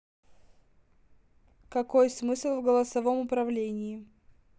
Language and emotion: Russian, neutral